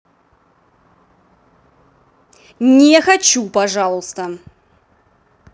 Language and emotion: Russian, angry